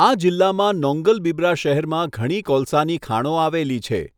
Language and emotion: Gujarati, neutral